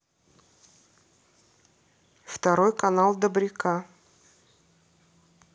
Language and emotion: Russian, neutral